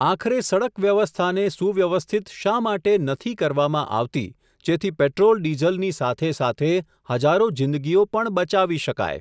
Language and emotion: Gujarati, neutral